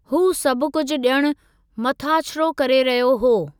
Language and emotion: Sindhi, neutral